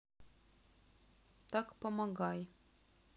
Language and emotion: Russian, sad